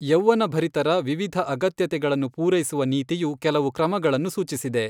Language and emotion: Kannada, neutral